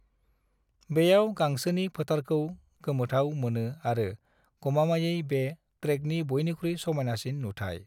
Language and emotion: Bodo, neutral